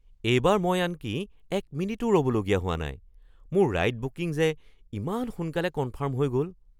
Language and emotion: Assamese, surprised